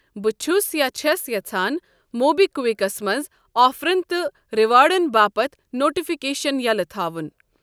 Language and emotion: Kashmiri, neutral